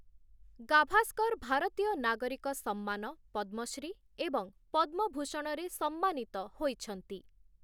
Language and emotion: Odia, neutral